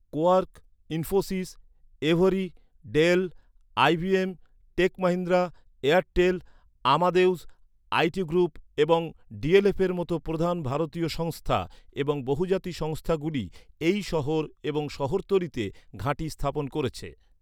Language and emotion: Bengali, neutral